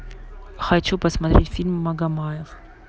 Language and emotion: Russian, neutral